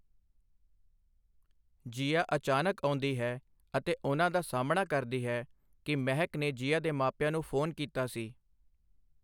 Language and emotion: Punjabi, neutral